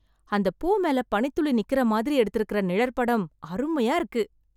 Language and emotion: Tamil, surprised